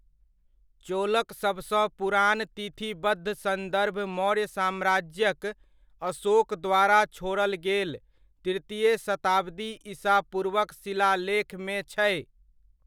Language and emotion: Maithili, neutral